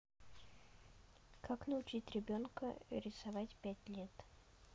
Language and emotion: Russian, neutral